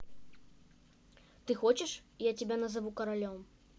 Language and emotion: Russian, neutral